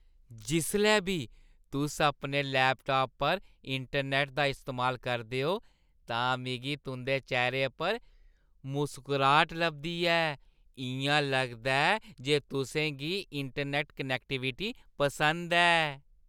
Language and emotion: Dogri, happy